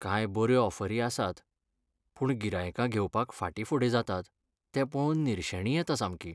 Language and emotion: Goan Konkani, sad